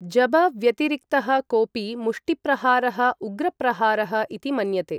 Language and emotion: Sanskrit, neutral